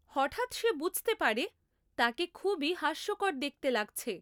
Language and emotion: Bengali, neutral